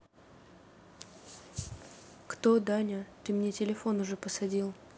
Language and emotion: Russian, neutral